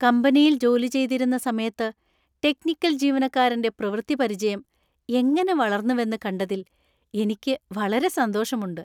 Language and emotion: Malayalam, happy